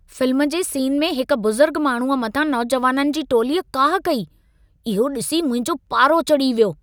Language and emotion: Sindhi, angry